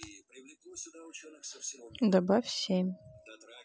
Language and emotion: Russian, neutral